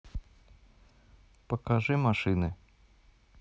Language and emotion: Russian, neutral